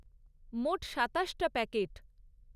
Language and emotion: Bengali, neutral